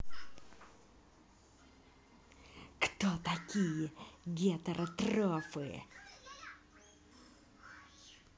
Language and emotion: Russian, angry